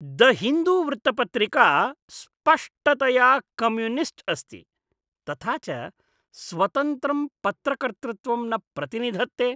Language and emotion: Sanskrit, disgusted